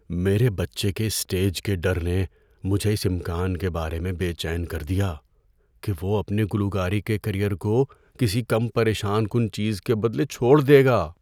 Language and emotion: Urdu, fearful